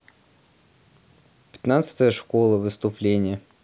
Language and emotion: Russian, neutral